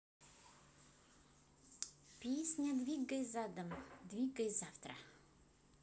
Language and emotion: Russian, neutral